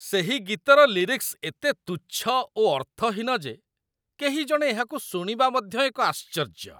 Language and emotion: Odia, disgusted